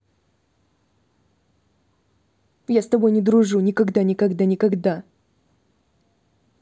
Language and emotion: Russian, angry